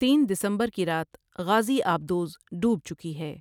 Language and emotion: Urdu, neutral